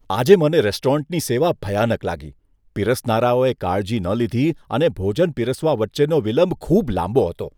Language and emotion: Gujarati, disgusted